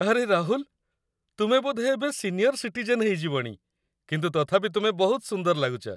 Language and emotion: Odia, happy